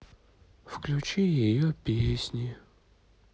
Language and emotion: Russian, sad